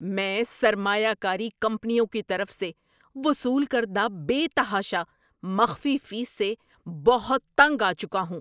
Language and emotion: Urdu, angry